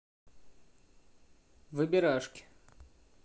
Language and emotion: Russian, neutral